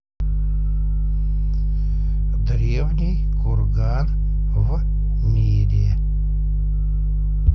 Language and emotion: Russian, neutral